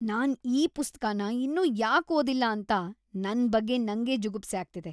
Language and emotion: Kannada, disgusted